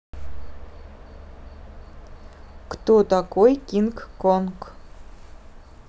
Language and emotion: Russian, neutral